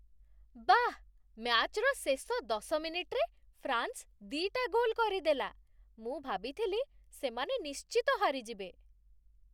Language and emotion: Odia, surprised